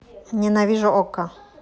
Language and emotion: Russian, neutral